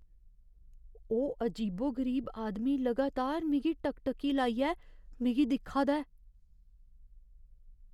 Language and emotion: Dogri, fearful